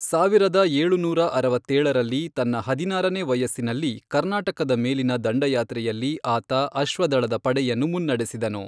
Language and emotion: Kannada, neutral